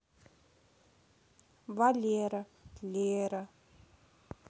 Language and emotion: Russian, neutral